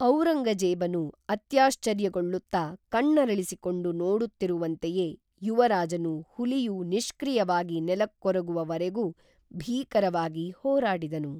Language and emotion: Kannada, neutral